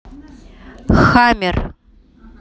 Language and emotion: Russian, neutral